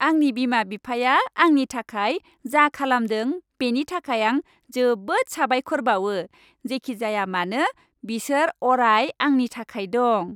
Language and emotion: Bodo, happy